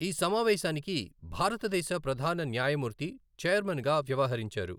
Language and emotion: Telugu, neutral